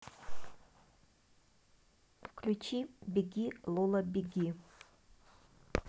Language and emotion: Russian, neutral